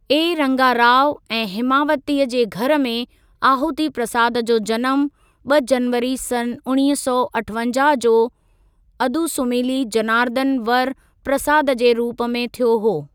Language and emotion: Sindhi, neutral